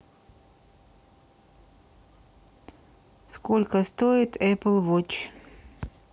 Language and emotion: Russian, neutral